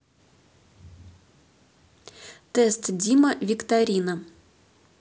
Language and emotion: Russian, neutral